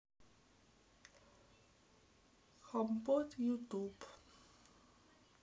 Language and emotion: Russian, neutral